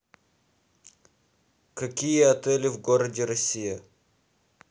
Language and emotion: Russian, neutral